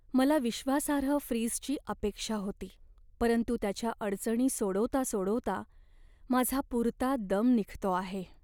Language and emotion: Marathi, sad